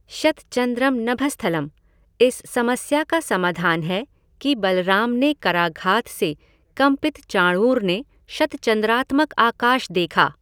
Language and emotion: Hindi, neutral